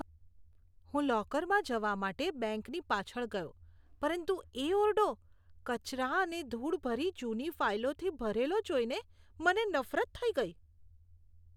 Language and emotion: Gujarati, disgusted